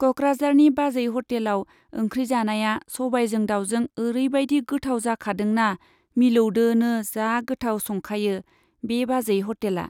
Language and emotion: Bodo, neutral